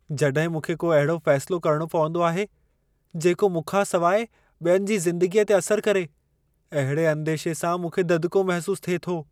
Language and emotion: Sindhi, fearful